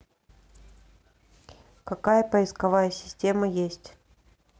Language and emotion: Russian, neutral